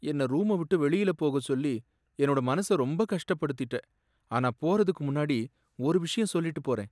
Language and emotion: Tamil, sad